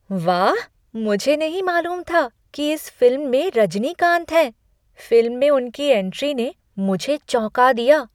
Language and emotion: Hindi, surprised